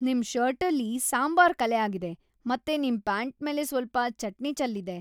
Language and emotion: Kannada, disgusted